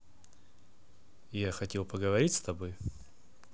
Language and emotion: Russian, neutral